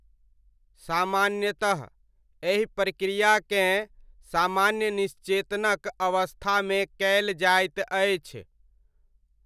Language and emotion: Maithili, neutral